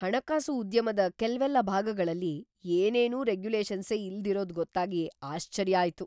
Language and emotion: Kannada, surprised